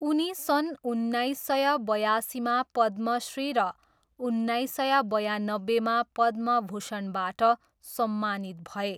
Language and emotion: Nepali, neutral